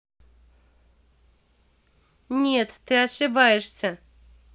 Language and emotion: Russian, angry